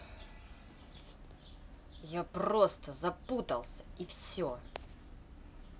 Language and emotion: Russian, angry